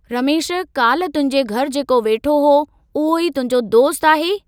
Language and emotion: Sindhi, neutral